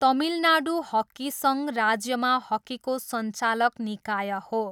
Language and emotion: Nepali, neutral